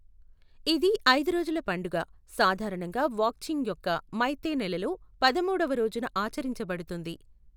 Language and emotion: Telugu, neutral